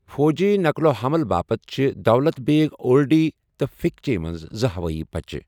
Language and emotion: Kashmiri, neutral